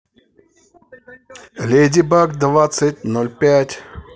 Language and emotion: Russian, positive